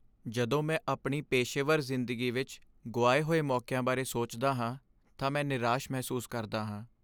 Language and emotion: Punjabi, sad